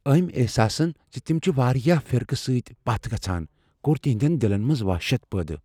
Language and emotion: Kashmiri, fearful